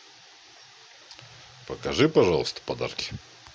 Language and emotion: Russian, neutral